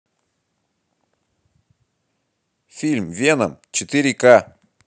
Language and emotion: Russian, positive